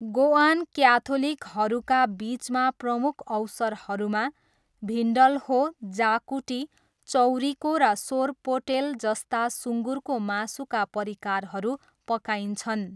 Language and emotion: Nepali, neutral